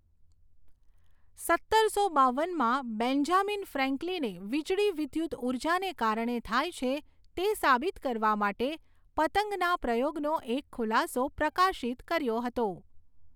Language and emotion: Gujarati, neutral